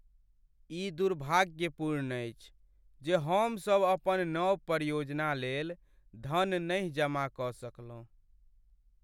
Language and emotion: Maithili, sad